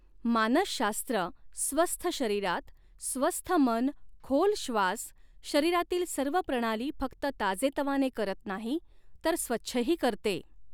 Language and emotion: Marathi, neutral